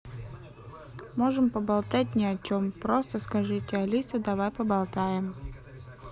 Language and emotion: Russian, neutral